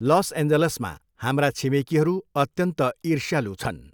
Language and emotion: Nepali, neutral